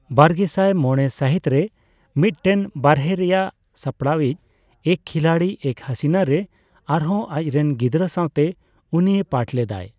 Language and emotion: Santali, neutral